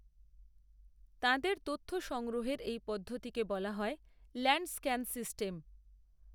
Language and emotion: Bengali, neutral